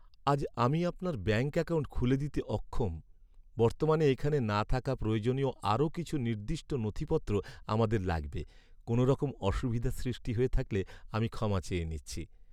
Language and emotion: Bengali, sad